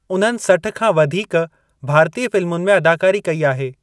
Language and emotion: Sindhi, neutral